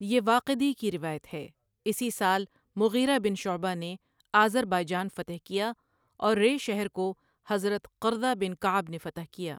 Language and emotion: Urdu, neutral